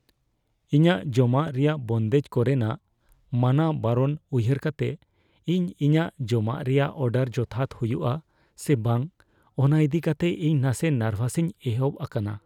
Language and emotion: Santali, fearful